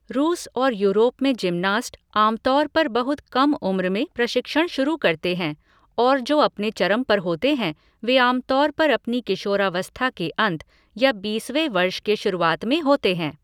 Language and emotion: Hindi, neutral